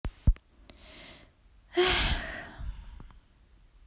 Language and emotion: Russian, sad